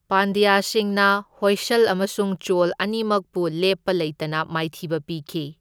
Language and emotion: Manipuri, neutral